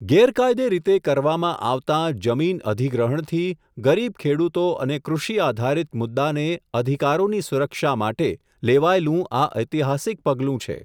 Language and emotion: Gujarati, neutral